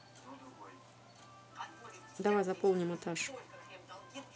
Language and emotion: Russian, neutral